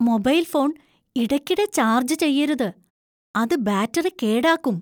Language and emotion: Malayalam, fearful